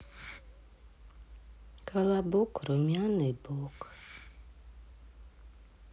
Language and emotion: Russian, sad